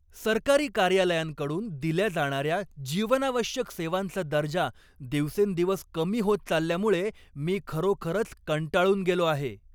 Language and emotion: Marathi, angry